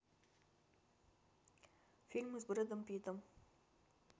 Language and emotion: Russian, neutral